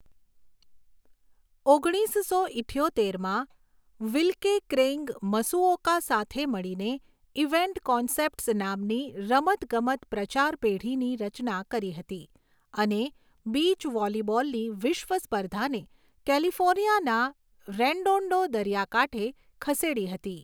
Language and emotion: Gujarati, neutral